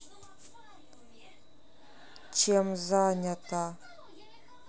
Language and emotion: Russian, neutral